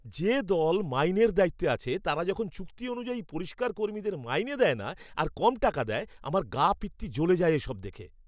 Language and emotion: Bengali, angry